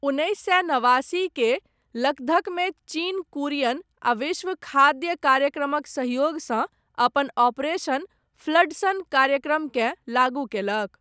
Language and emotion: Maithili, neutral